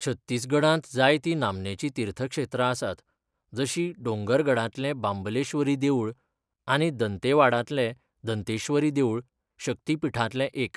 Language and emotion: Goan Konkani, neutral